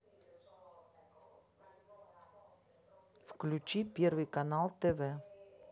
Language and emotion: Russian, neutral